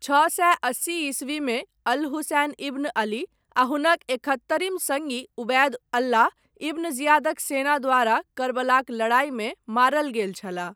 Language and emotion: Maithili, neutral